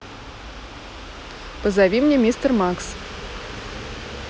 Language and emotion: Russian, neutral